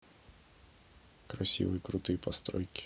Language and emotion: Russian, neutral